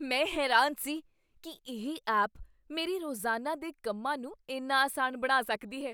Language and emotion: Punjabi, surprised